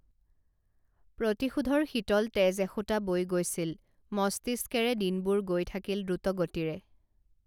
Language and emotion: Assamese, neutral